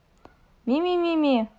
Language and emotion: Russian, neutral